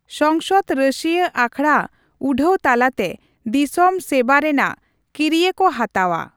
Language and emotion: Santali, neutral